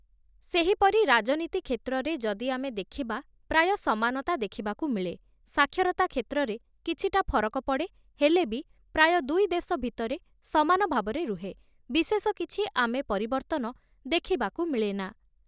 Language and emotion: Odia, neutral